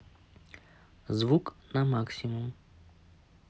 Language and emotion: Russian, neutral